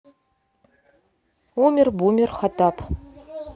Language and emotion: Russian, neutral